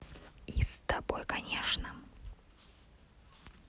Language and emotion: Russian, neutral